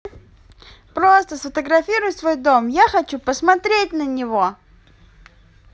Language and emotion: Russian, positive